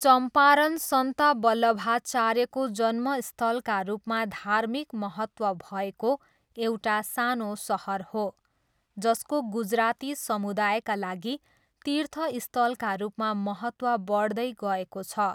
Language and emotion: Nepali, neutral